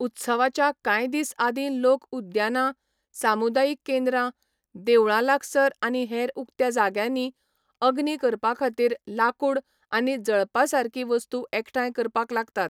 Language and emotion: Goan Konkani, neutral